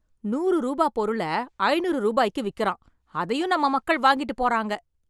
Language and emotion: Tamil, angry